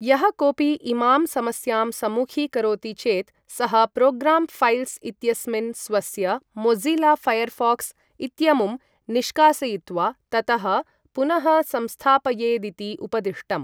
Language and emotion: Sanskrit, neutral